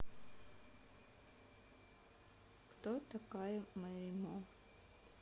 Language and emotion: Russian, neutral